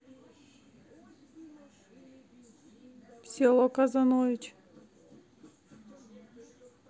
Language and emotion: Russian, neutral